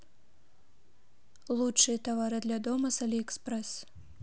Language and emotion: Russian, neutral